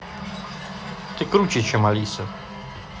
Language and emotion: Russian, positive